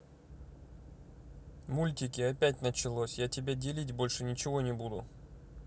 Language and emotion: Russian, neutral